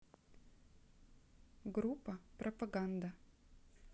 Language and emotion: Russian, neutral